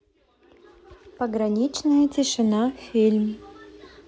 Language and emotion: Russian, neutral